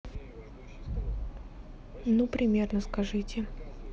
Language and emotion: Russian, neutral